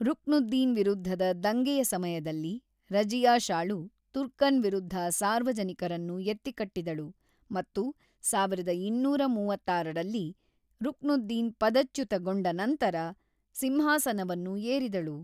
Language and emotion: Kannada, neutral